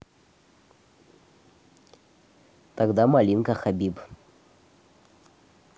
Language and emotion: Russian, neutral